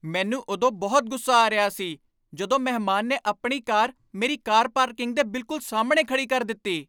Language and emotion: Punjabi, angry